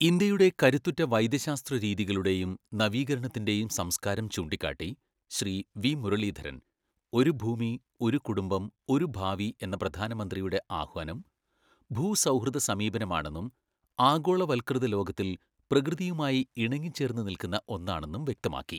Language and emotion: Malayalam, neutral